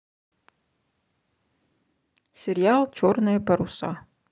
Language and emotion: Russian, neutral